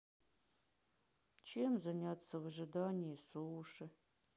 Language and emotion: Russian, sad